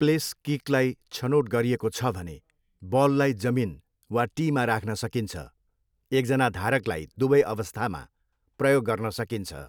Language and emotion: Nepali, neutral